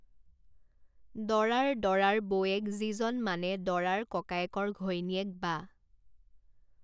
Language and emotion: Assamese, neutral